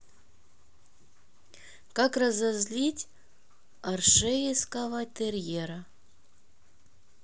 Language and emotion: Russian, neutral